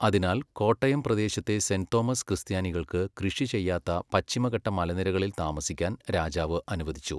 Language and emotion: Malayalam, neutral